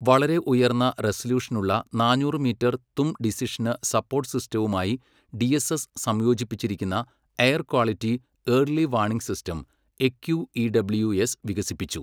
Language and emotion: Malayalam, neutral